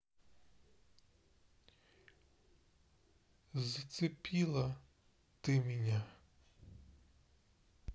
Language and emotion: Russian, sad